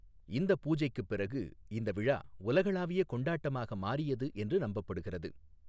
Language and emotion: Tamil, neutral